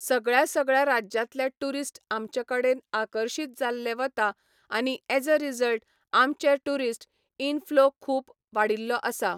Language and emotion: Goan Konkani, neutral